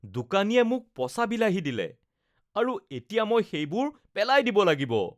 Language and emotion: Assamese, disgusted